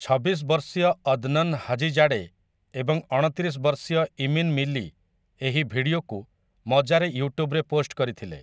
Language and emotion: Odia, neutral